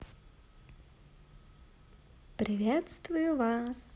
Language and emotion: Russian, positive